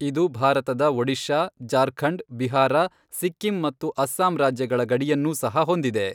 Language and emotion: Kannada, neutral